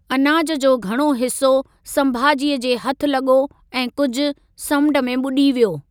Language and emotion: Sindhi, neutral